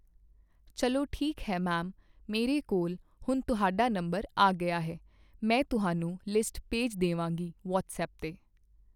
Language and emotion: Punjabi, neutral